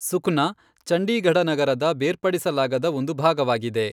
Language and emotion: Kannada, neutral